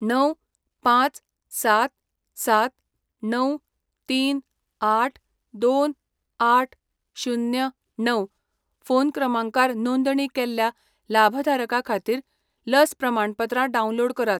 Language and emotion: Goan Konkani, neutral